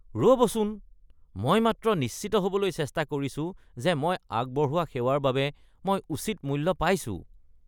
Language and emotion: Assamese, disgusted